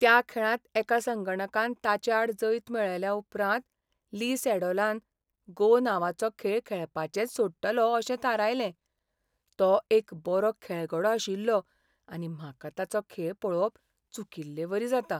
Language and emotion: Goan Konkani, sad